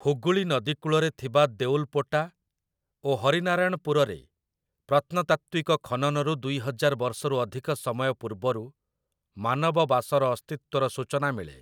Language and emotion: Odia, neutral